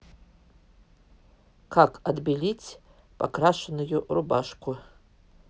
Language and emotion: Russian, neutral